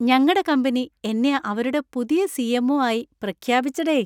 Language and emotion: Malayalam, happy